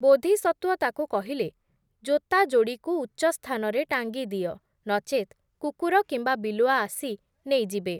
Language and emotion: Odia, neutral